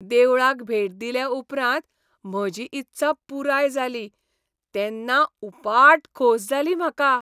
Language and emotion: Goan Konkani, happy